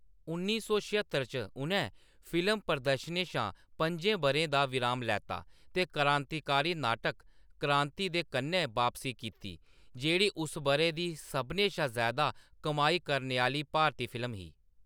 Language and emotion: Dogri, neutral